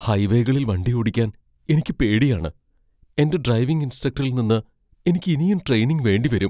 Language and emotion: Malayalam, fearful